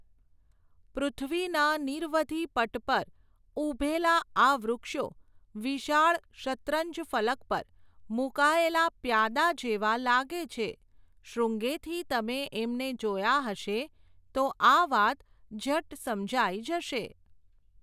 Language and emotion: Gujarati, neutral